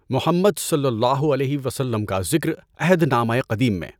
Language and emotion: Urdu, neutral